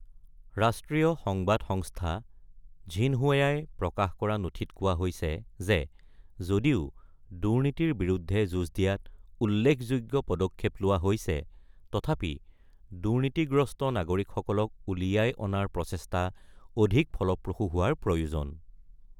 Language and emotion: Assamese, neutral